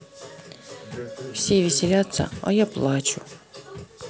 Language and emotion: Russian, sad